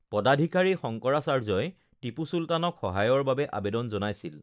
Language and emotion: Assamese, neutral